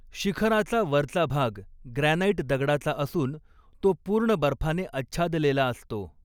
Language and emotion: Marathi, neutral